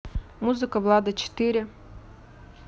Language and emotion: Russian, neutral